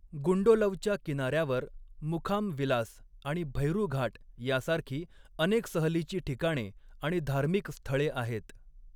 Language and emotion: Marathi, neutral